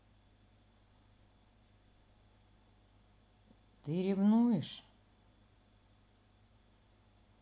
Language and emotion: Russian, sad